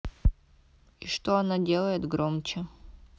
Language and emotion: Russian, neutral